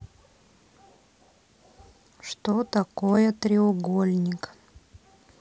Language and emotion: Russian, neutral